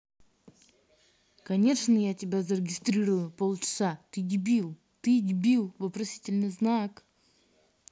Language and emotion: Russian, angry